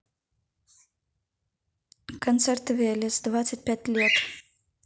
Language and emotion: Russian, neutral